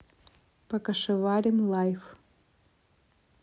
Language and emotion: Russian, neutral